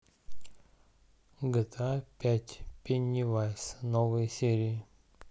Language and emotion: Russian, neutral